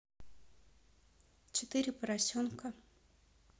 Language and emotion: Russian, neutral